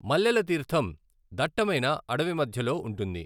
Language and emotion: Telugu, neutral